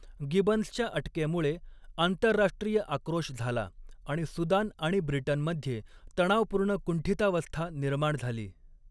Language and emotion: Marathi, neutral